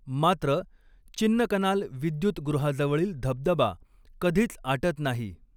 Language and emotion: Marathi, neutral